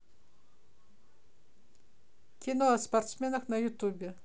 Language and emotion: Russian, neutral